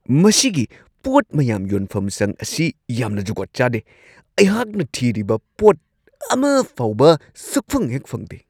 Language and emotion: Manipuri, angry